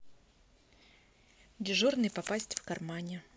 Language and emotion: Russian, neutral